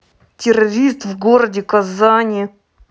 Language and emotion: Russian, angry